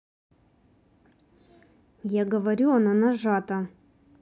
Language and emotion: Russian, angry